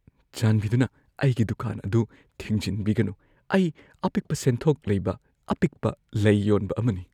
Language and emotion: Manipuri, fearful